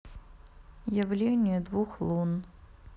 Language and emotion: Russian, neutral